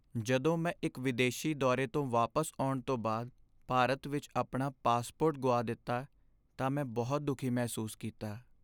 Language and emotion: Punjabi, sad